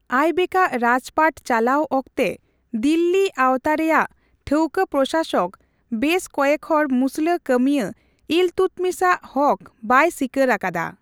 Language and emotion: Santali, neutral